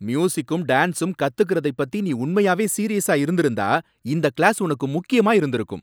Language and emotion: Tamil, angry